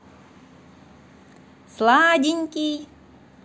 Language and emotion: Russian, positive